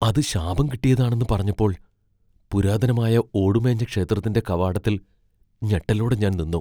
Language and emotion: Malayalam, fearful